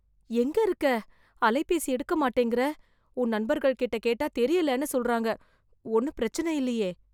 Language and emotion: Tamil, fearful